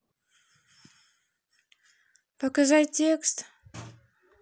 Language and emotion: Russian, neutral